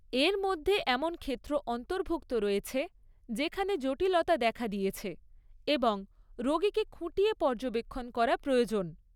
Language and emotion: Bengali, neutral